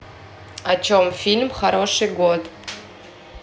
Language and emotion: Russian, neutral